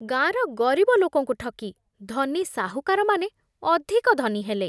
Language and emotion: Odia, disgusted